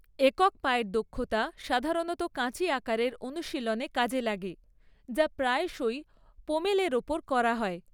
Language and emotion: Bengali, neutral